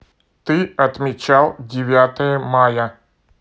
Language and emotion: Russian, neutral